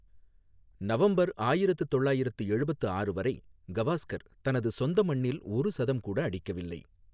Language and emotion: Tamil, neutral